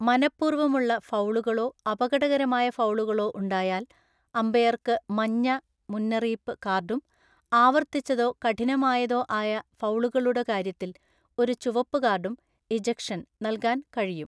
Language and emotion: Malayalam, neutral